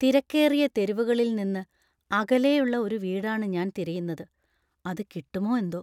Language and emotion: Malayalam, fearful